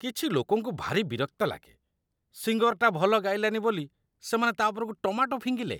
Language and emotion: Odia, disgusted